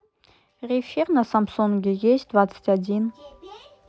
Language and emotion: Russian, neutral